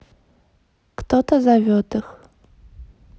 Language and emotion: Russian, neutral